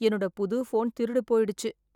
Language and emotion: Tamil, sad